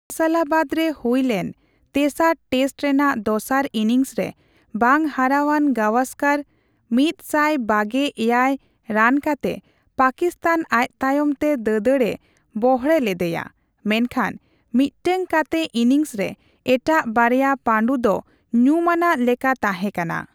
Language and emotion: Santali, neutral